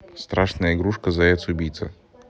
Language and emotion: Russian, neutral